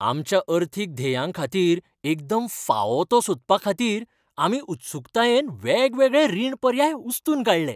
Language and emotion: Goan Konkani, happy